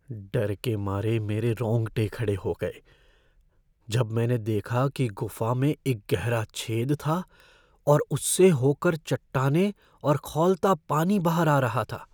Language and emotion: Hindi, fearful